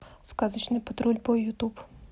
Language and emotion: Russian, neutral